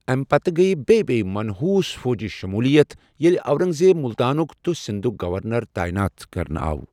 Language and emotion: Kashmiri, neutral